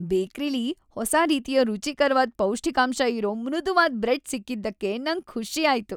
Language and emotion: Kannada, happy